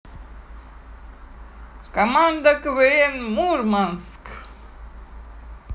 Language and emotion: Russian, positive